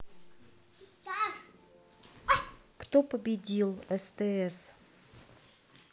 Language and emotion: Russian, neutral